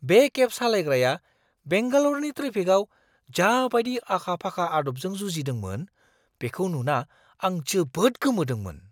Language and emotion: Bodo, surprised